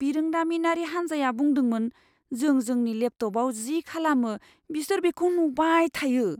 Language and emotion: Bodo, fearful